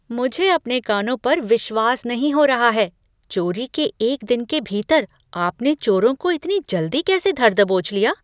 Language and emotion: Hindi, surprised